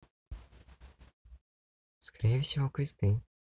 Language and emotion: Russian, neutral